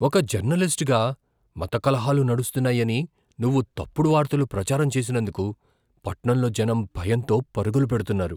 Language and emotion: Telugu, fearful